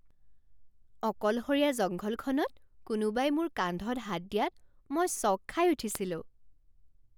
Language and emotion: Assamese, surprised